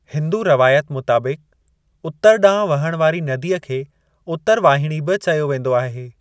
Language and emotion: Sindhi, neutral